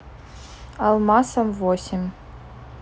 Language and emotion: Russian, neutral